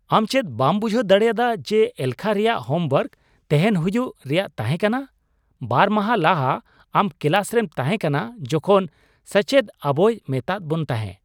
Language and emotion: Santali, surprised